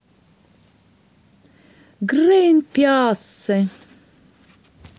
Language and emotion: Russian, positive